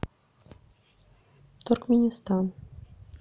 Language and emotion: Russian, neutral